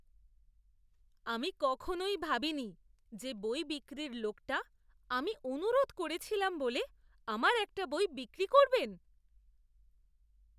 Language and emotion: Bengali, surprised